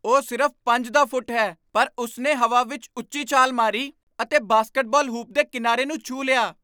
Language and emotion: Punjabi, surprised